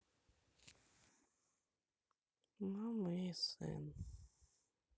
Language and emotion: Russian, sad